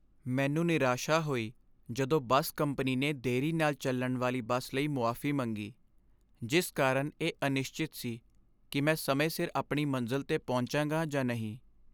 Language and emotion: Punjabi, sad